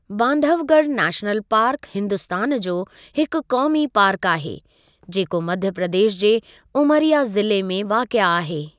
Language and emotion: Sindhi, neutral